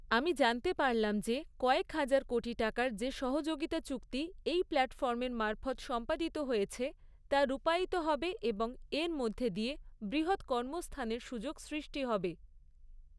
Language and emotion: Bengali, neutral